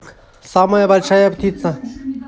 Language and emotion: Russian, neutral